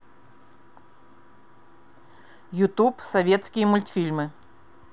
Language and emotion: Russian, neutral